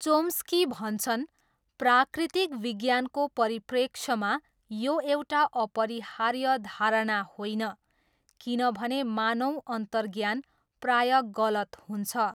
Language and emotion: Nepali, neutral